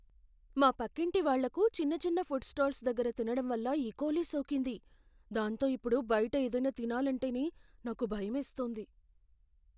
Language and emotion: Telugu, fearful